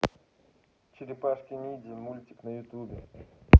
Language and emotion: Russian, neutral